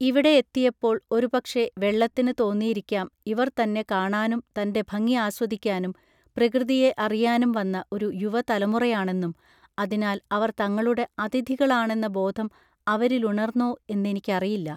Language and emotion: Malayalam, neutral